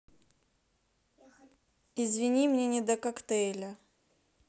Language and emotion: Russian, neutral